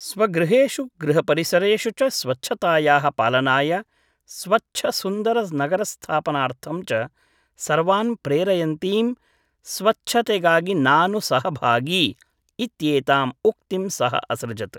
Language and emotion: Sanskrit, neutral